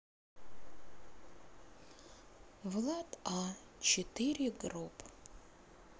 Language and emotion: Russian, sad